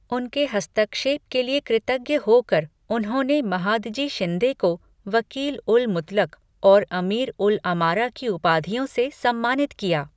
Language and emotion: Hindi, neutral